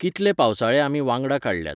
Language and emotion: Goan Konkani, neutral